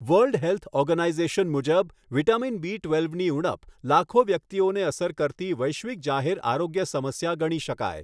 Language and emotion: Gujarati, neutral